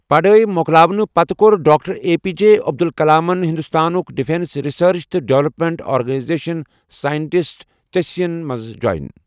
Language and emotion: Kashmiri, neutral